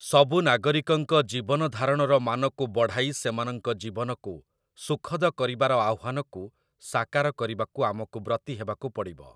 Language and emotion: Odia, neutral